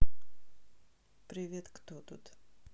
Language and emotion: Russian, neutral